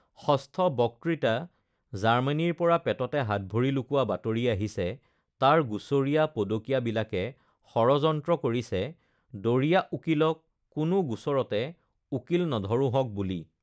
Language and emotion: Assamese, neutral